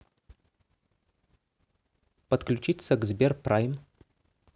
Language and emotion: Russian, neutral